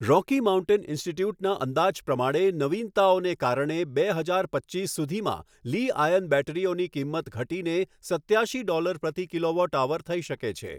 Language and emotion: Gujarati, neutral